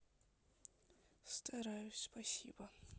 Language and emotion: Russian, sad